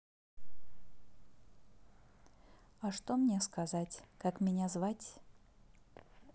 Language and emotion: Russian, neutral